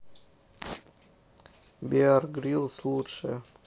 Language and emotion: Russian, neutral